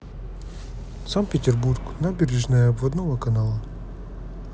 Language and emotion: Russian, neutral